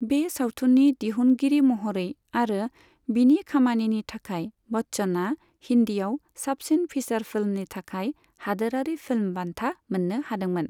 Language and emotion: Bodo, neutral